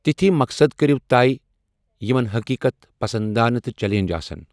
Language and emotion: Kashmiri, neutral